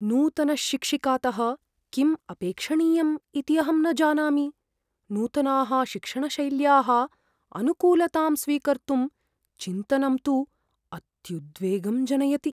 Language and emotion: Sanskrit, fearful